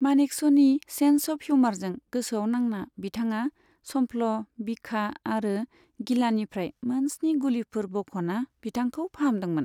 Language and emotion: Bodo, neutral